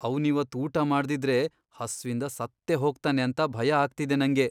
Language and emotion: Kannada, fearful